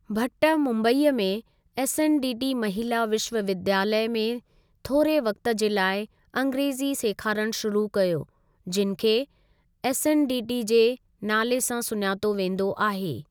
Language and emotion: Sindhi, neutral